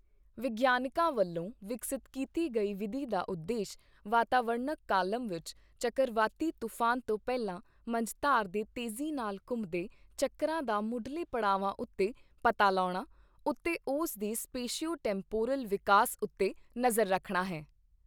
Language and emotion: Punjabi, neutral